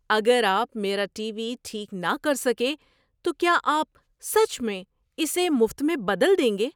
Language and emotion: Urdu, surprised